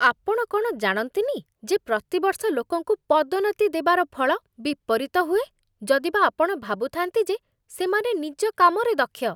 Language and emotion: Odia, disgusted